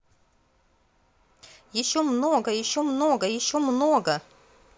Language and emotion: Russian, positive